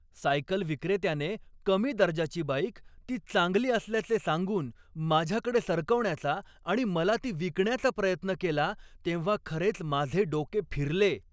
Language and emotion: Marathi, angry